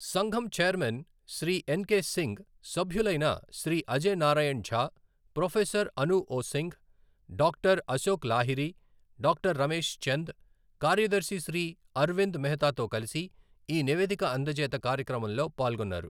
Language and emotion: Telugu, neutral